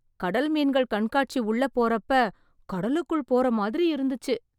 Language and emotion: Tamil, surprised